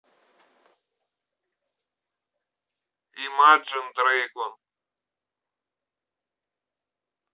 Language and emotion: Russian, neutral